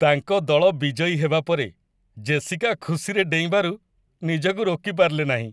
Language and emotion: Odia, happy